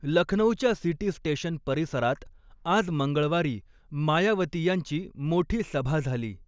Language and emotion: Marathi, neutral